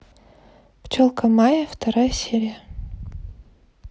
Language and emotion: Russian, neutral